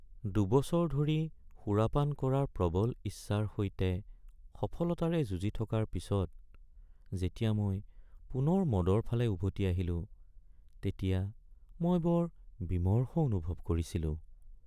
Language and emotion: Assamese, sad